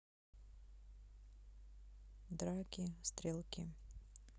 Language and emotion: Russian, neutral